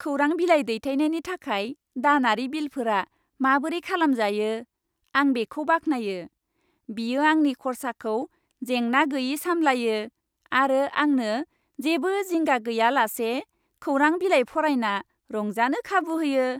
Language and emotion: Bodo, happy